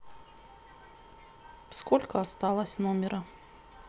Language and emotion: Russian, neutral